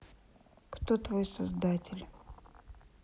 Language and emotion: Russian, sad